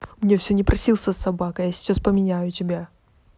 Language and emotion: Russian, angry